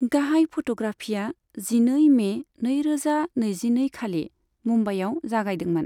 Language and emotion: Bodo, neutral